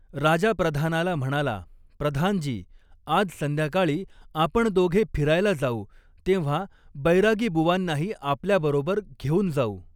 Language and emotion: Marathi, neutral